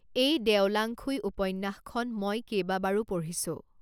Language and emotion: Assamese, neutral